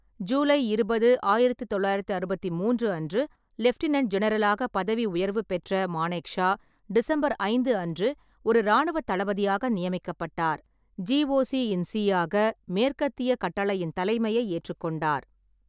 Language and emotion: Tamil, neutral